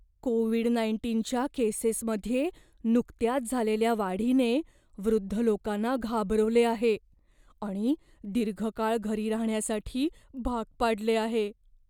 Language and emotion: Marathi, fearful